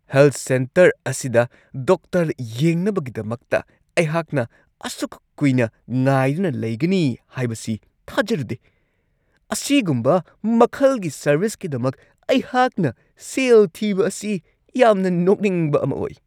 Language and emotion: Manipuri, angry